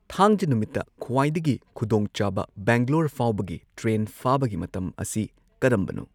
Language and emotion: Manipuri, neutral